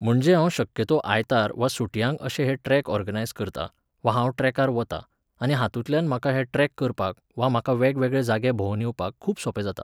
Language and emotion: Goan Konkani, neutral